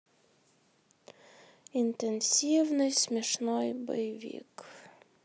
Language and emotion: Russian, sad